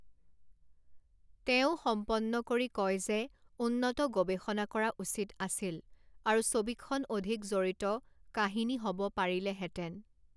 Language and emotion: Assamese, neutral